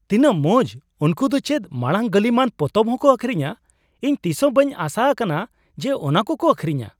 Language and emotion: Santali, surprised